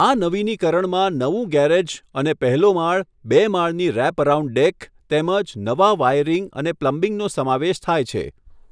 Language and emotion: Gujarati, neutral